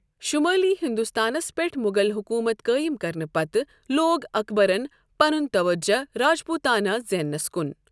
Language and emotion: Kashmiri, neutral